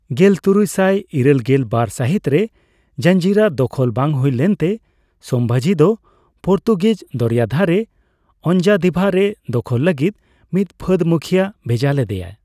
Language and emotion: Santali, neutral